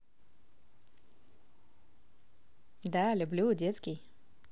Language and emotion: Russian, positive